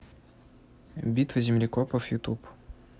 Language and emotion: Russian, neutral